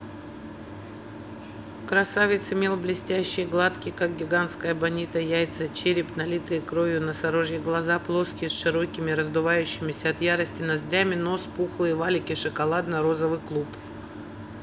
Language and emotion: Russian, neutral